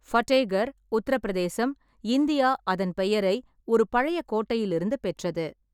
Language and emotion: Tamil, neutral